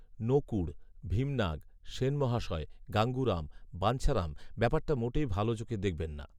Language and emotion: Bengali, neutral